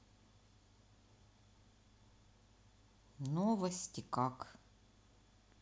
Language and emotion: Russian, neutral